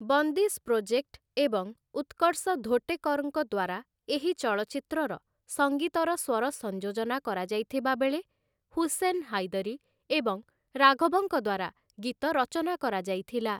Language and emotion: Odia, neutral